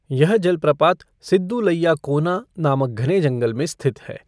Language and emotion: Hindi, neutral